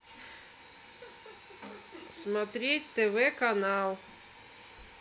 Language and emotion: Russian, neutral